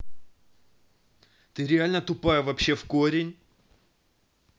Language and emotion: Russian, angry